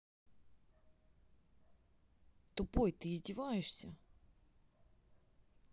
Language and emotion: Russian, angry